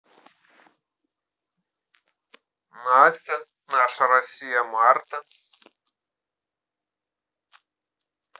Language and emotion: Russian, positive